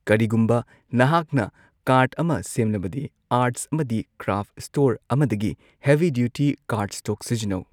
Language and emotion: Manipuri, neutral